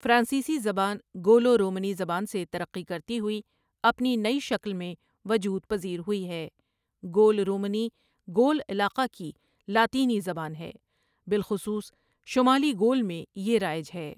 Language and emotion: Urdu, neutral